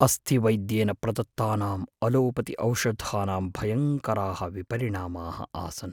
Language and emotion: Sanskrit, fearful